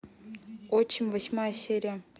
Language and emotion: Russian, neutral